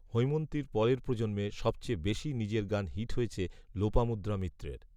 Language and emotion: Bengali, neutral